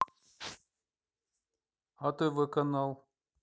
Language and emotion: Russian, neutral